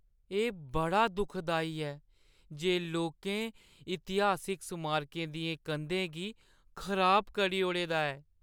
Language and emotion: Dogri, sad